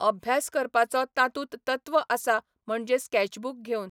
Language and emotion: Goan Konkani, neutral